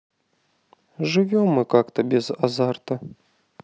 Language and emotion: Russian, sad